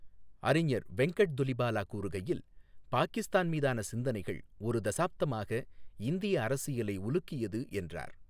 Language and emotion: Tamil, neutral